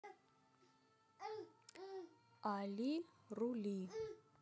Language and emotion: Russian, neutral